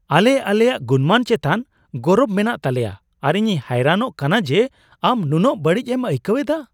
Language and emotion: Santali, surprised